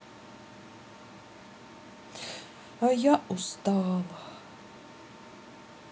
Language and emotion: Russian, sad